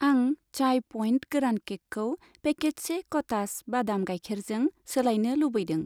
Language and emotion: Bodo, neutral